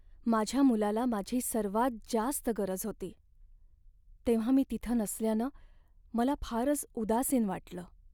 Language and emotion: Marathi, sad